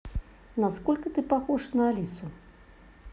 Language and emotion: Russian, neutral